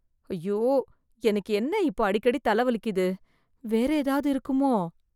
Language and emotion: Tamil, fearful